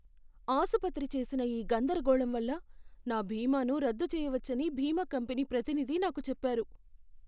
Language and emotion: Telugu, fearful